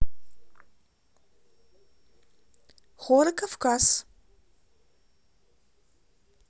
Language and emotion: Russian, neutral